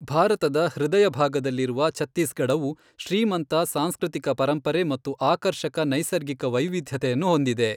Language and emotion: Kannada, neutral